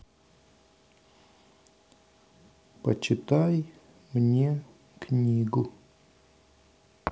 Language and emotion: Russian, neutral